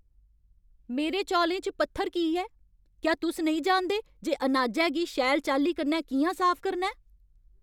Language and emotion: Dogri, angry